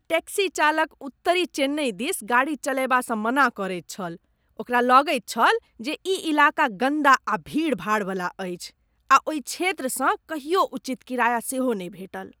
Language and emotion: Maithili, disgusted